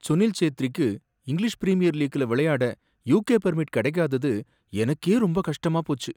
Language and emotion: Tamil, sad